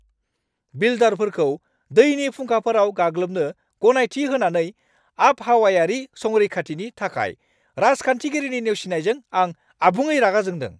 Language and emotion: Bodo, angry